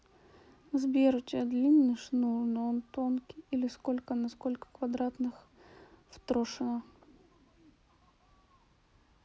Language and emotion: Russian, sad